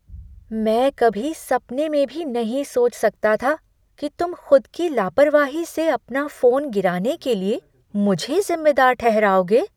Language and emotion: Hindi, surprised